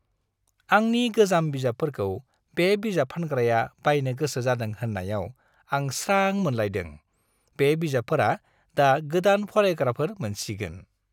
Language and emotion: Bodo, happy